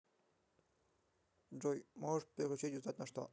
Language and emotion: Russian, neutral